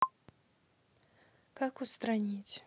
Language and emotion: Russian, neutral